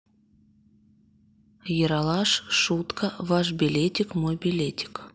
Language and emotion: Russian, neutral